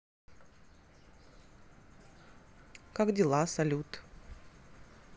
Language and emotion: Russian, neutral